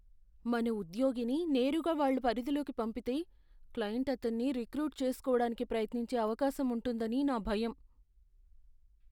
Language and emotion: Telugu, fearful